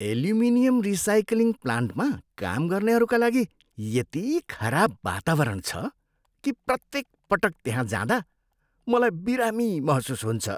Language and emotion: Nepali, disgusted